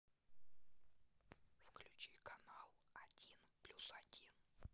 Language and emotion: Russian, neutral